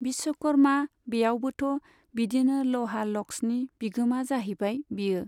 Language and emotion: Bodo, neutral